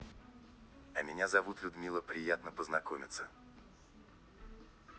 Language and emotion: Russian, neutral